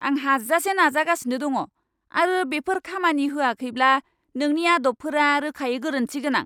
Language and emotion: Bodo, angry